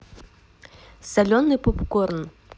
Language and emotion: Russian, neutral